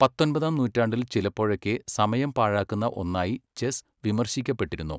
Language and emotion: Malayalam, neutral